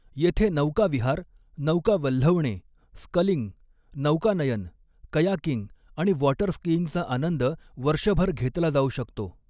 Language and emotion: Marathi, neutral